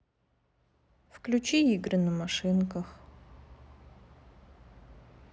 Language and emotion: Russian, sad